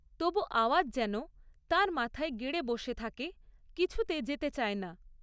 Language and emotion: Bengali, neutral